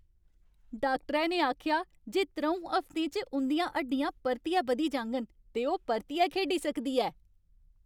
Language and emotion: Dogri, happy